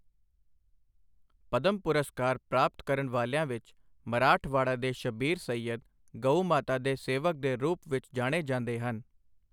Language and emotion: Punjabi, neutral